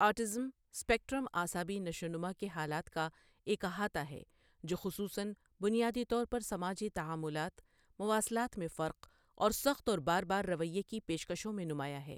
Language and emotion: Urdu, neutral